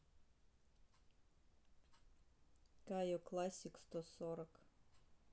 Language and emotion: Russian, neutral